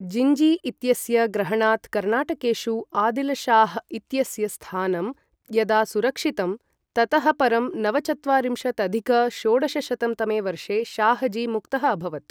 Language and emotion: Sanskrit, neutral